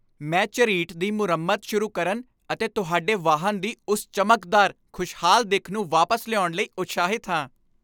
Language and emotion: Punjabi, happy